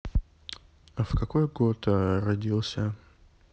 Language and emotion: Russian, neutral